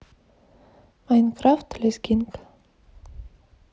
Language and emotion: Russian, neutral